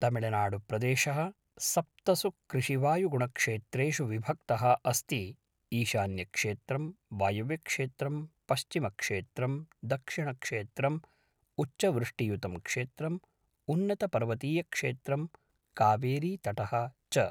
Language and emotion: Sanskrit, neutral